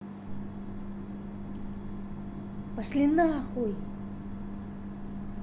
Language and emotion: Russian, angry